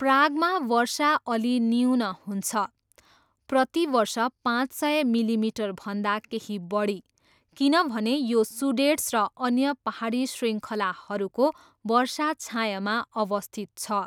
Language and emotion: Nepali, neutral